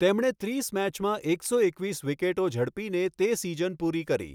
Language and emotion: Gujarati, neutral